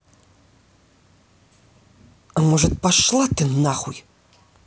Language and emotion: Russian, angry